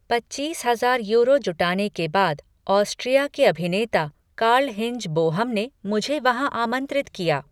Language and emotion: Hindi, neutral